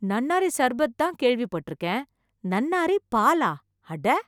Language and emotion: Tamil, surprised